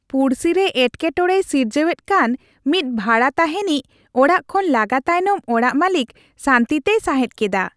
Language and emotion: Santali, happy